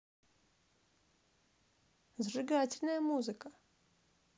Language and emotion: Russian, positive